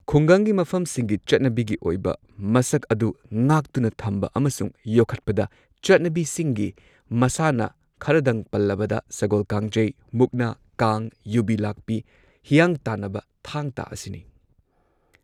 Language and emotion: Manipuri, neutral